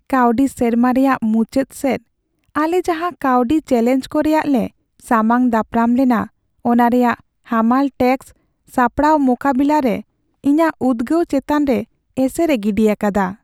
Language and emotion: Santali, sad